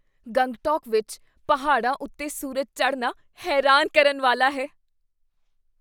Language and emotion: Punjabi, surprised